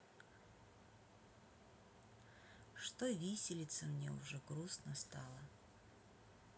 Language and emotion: Russian, sad